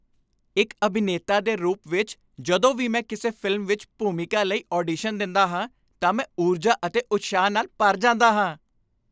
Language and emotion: Punjabi, happy